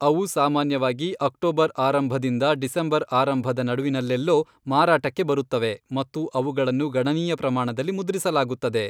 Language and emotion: Kannada, neutral